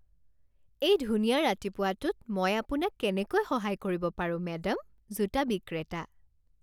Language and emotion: Assamese, happy